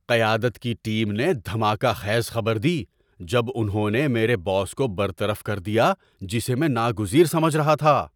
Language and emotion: Urdu, surprised